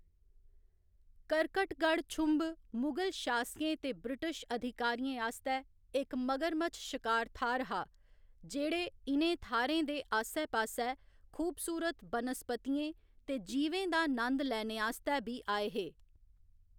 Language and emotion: Dogri, neutral